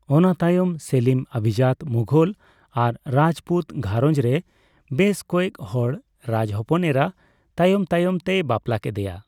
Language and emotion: Santali, neutral